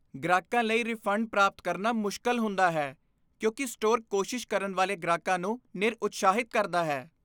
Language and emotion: Punjabi, disgusted